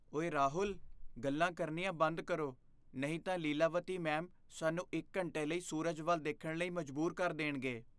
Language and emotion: Punjabi, fearful